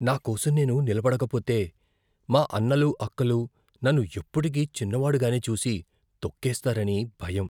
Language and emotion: Telugu, fearful